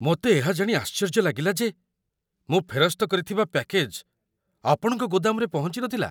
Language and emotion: Odia, surprised